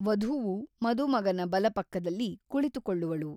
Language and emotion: Kannada, neutral